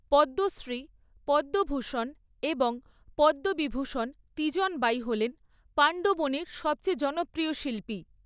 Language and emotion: Bengali, neutral